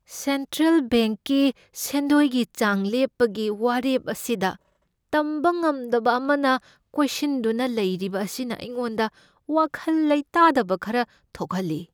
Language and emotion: Manipuri, fearful